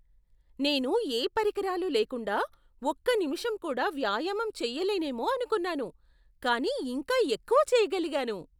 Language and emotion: Telugu, surprised